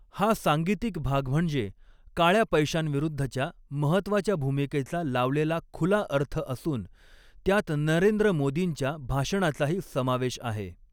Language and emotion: Marathi, neutral